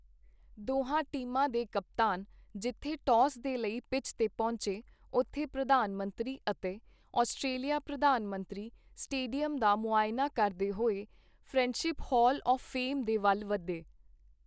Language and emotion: Punjabi, neutral